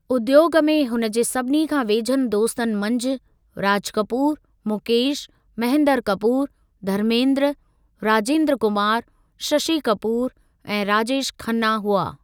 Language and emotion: Sindhi, neutral